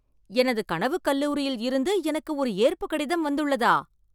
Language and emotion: Tamil, surprised